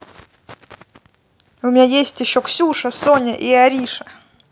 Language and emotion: Russian, positive